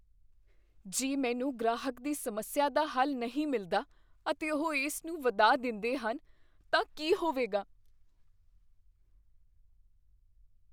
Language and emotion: Punjabi, fearful